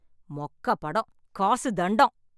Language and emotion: Tamil, angry